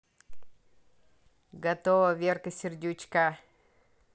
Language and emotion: Russian, positive